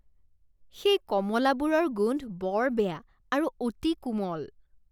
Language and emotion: Assamese, disgusted